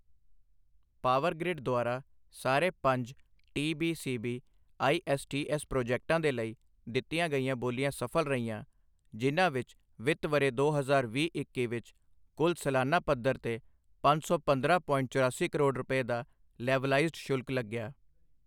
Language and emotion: Punjabi, neutral